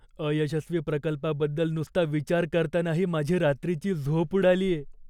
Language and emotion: Marathi, fearful